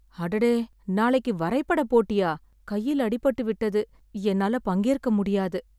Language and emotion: Tamil, sad